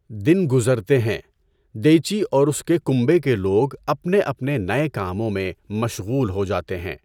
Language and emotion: Urdu, neutral